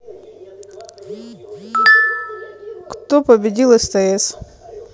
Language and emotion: Russian, neutral